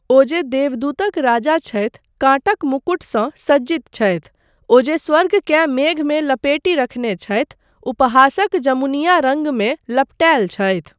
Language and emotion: Maithili, neutral